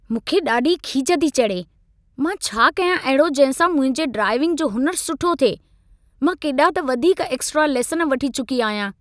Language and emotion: Sindhi, angry